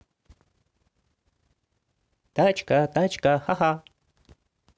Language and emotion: Russian, positive